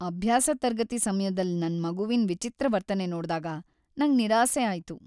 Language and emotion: Kannada, sad